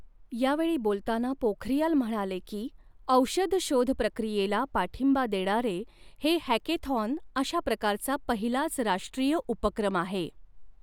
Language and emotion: Marathi, neutral